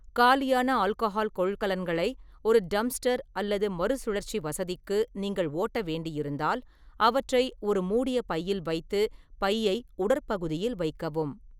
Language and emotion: Tamil, neutral